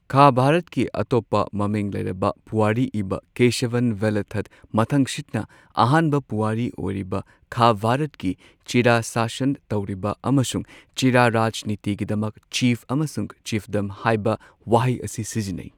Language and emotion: Manipuri, neutral